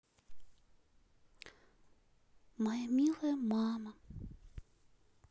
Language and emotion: Russian, sad